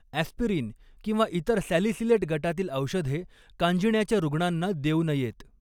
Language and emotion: Marathi, neutral